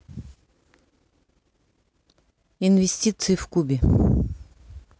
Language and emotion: Russian, neutral